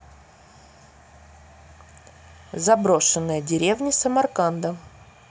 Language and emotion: Russian, neutral